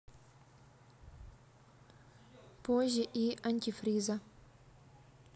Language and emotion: Russian, neutral